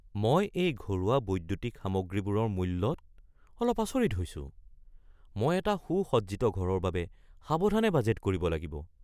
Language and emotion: Assamese, surprised